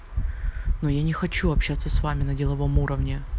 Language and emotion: Russian, neutral